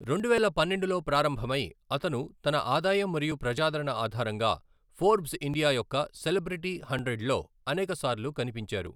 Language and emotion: Telugu, neutral